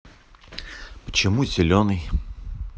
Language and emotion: Russian, neutral